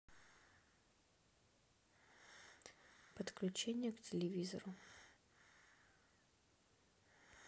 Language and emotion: Russian, neutral